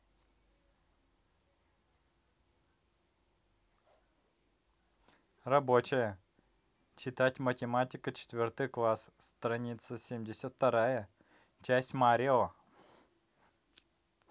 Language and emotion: Russian, positive